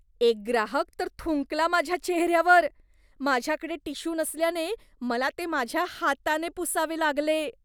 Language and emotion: Marathi, disgusted